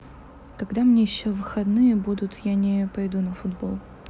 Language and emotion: Russian, neutral